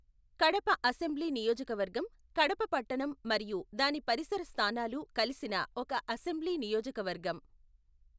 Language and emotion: Telugu, neutral